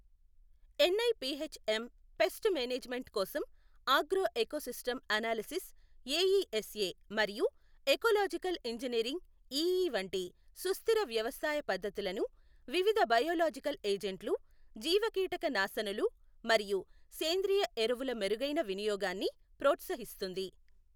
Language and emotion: Telugu, neutral